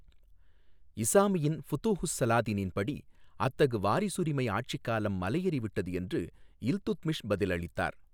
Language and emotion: Tamil, neutral